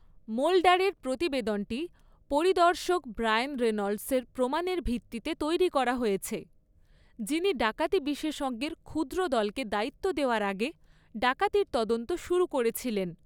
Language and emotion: Bengali, neutral